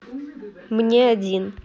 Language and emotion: Russian, neutral